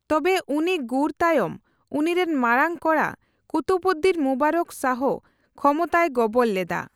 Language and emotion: Santali, neutral